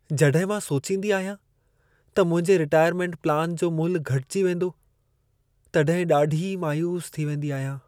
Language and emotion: Sindhi, sad